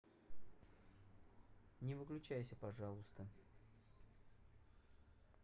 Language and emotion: Russian, neutral